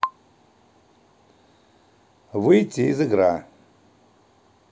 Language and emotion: Russian, neutral